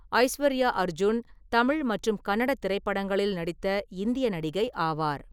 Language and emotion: Tamil, neutral